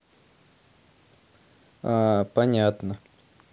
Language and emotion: Russian, neutral